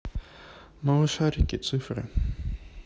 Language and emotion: Russian, neutral